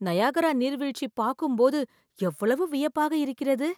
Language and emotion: Tamil, surprised